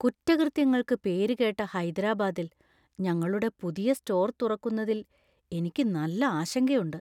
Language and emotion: Malayalam, fearful